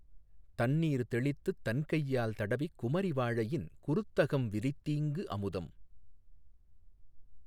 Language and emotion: Tamil, neutral